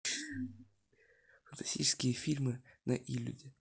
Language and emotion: Russian, neutral